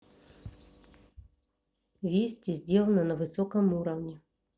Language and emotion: Russian, neutral